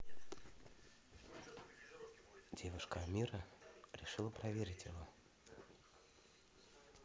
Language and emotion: Russian, neutral